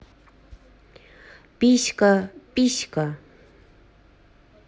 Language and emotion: Russian, neutral